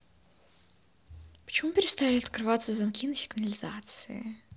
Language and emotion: Russian, angry